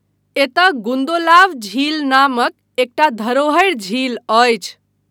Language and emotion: Maithili, neutral